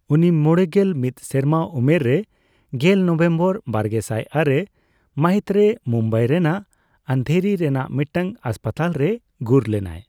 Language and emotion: Santali, neutral